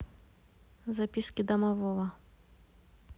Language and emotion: Russian, neutral